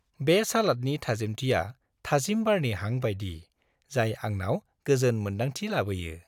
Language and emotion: Bodo, happy